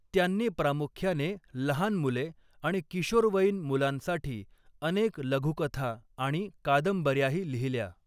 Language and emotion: Marathi, neutral